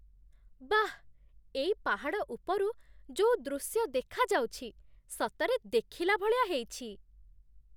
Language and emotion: Odia, surprised